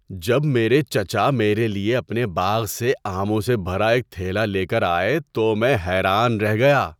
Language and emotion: Urdu, surprised